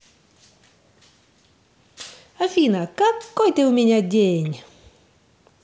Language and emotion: Russian, positive